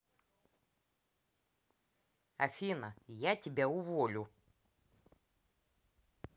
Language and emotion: Russian, angry